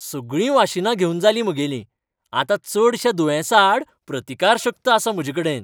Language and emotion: Goan Konkani, happy